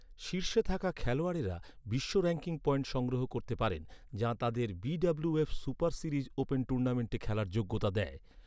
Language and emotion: Bengali, neutral